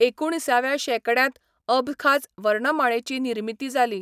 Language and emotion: Goan Konkani, neutral